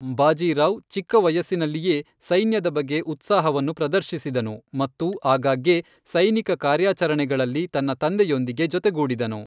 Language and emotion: Kannada, neutral